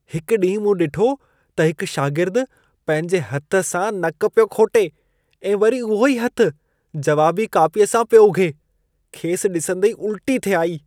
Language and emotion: Sindhi, disgusted